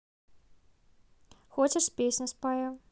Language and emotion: Russian, neutral